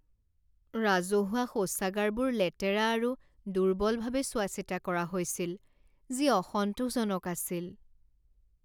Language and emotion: Assamese, sad